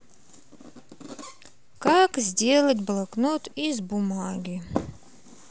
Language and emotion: Russian, neutral